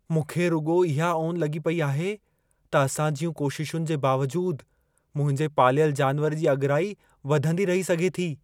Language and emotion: Sindhi, fearful